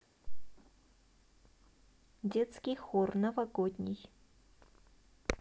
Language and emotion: Russian, neutral